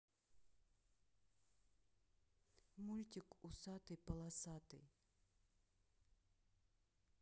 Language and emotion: Russian, neutral